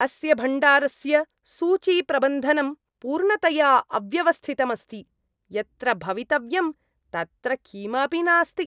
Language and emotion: Sanskrit, disgusted